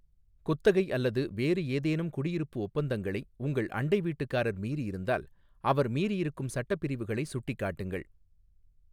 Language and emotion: Tamil, neutral